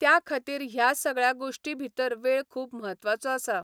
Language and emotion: Goan Konkani, neutral